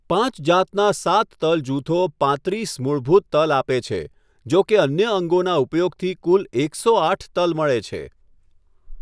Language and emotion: Gujarati, neutral